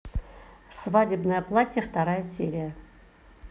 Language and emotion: Russian, neutral